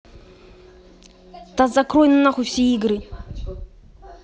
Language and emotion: Russian, angry